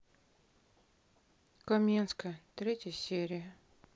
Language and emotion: Russian, sad